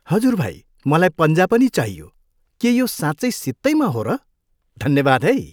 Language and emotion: Nepali, happy